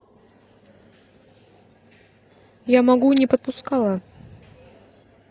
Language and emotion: Russian, neutral